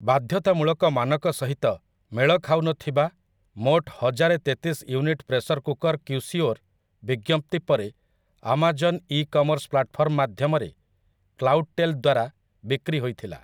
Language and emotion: Odia, neutral